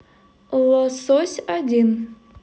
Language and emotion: Russian, positive